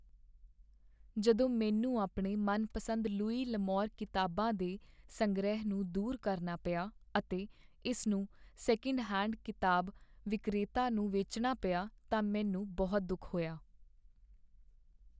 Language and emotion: Punjabi, sad